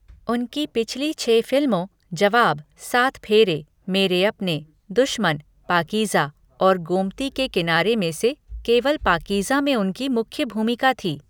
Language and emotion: Hindi, neutral